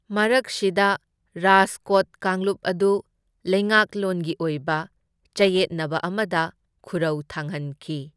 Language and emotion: Manipuri, neutral